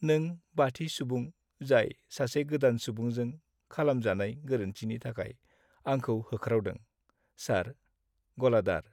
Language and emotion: Bodo, sad